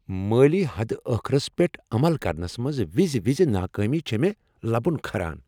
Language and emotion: Kashmiri, angry